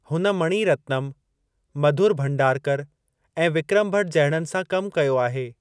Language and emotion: Sindhi, neutral